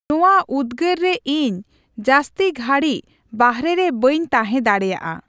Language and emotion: Santali, neutral